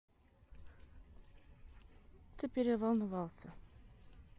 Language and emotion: Russian, neutral